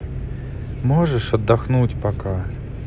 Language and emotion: Russian, sad